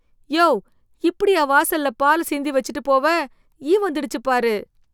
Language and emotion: Tamil, disgusted